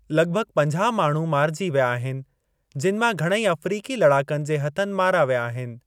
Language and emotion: Sindhi, neutral